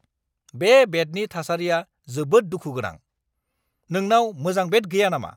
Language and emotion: Bodo, angry